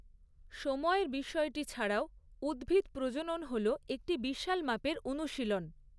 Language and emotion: Bengali, neutral